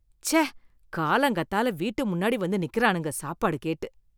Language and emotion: Tamil, disgusted